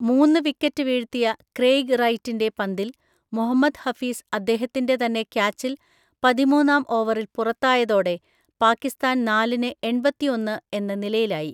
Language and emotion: Malayalam, neutral